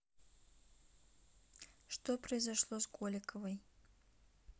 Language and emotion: Russian, neutral